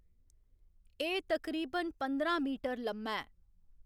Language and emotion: Dogri, neutral